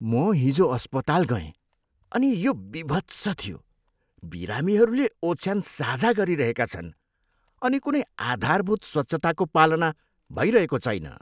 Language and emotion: Nepali, disgusted